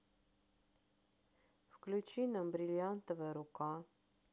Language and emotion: Russian, neutral